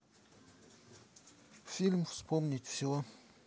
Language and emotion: Russian, neutral